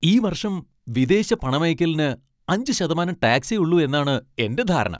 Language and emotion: Malayalam, happy